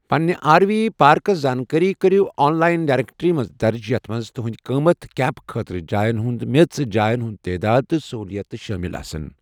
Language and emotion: Kashmiri, neutral